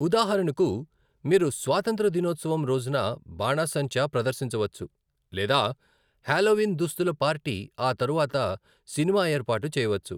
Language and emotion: Telugu, neutral